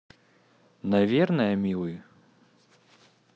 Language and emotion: Russian, neutral